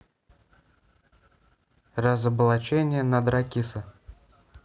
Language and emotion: Russian, neutral